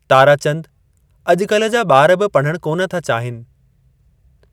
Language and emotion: Sindhi, neutral